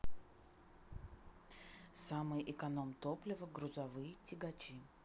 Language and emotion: Russian, neutral